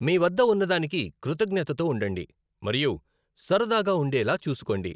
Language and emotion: Telugu, neutral